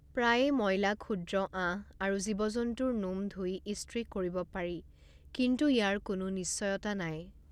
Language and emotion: Assamese, neutral